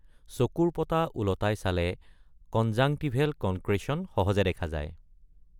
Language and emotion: Assamese, neutral